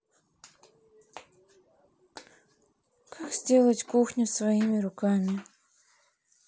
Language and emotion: Russian, sad